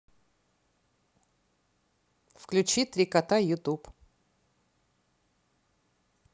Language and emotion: Russian, neutral